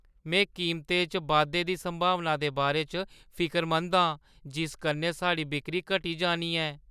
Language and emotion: Dogri, fearful